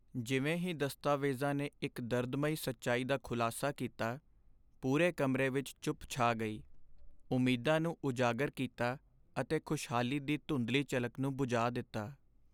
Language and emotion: Punjabi, sad